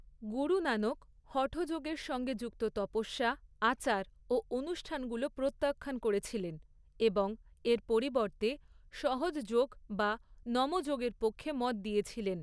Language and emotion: Bengali, neutral